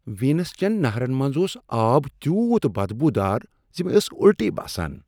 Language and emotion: Kashmiri, disgusted